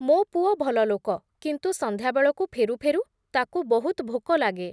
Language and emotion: Odia, neutral